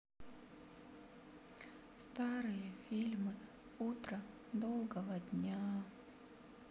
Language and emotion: Russian, sad